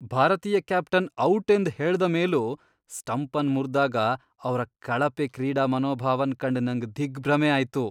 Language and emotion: Kannada, disgusted